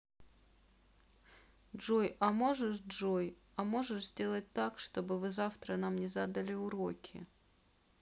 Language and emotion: Russian, sad